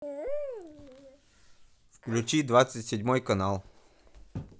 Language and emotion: Russian, neutral